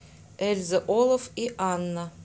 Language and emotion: Russian, neutral